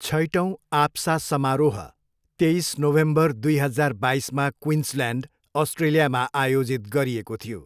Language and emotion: Nepali, neutral